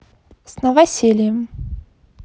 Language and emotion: Russian, positive